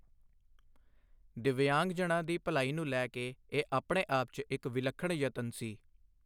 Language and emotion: Punjabi, neutral